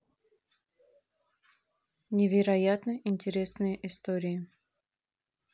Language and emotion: Russian, neutral